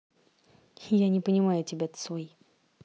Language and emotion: Russian, neutral